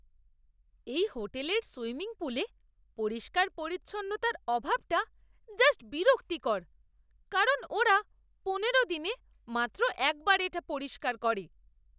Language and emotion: Bengali, disgusted